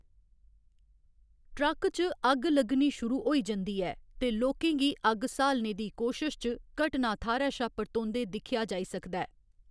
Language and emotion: Dogri, neutral